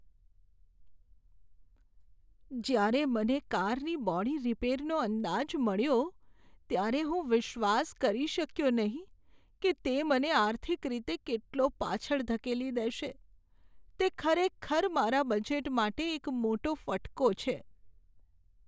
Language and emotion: Gujarati, sad